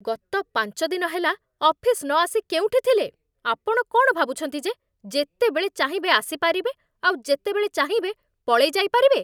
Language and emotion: Odia, angry